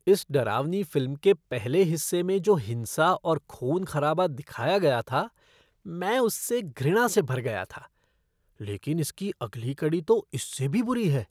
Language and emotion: Hindi, disgusted